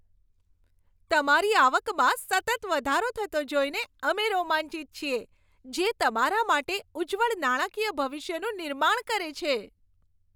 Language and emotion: Gujarati, happy